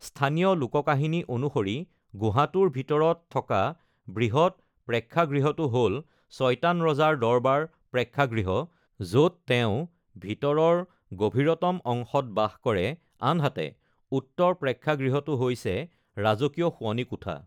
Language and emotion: Assamese, neutral